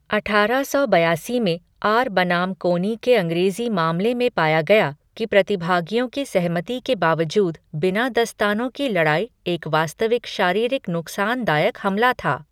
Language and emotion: Hindi, neutral